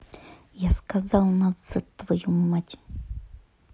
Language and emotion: Russian, angry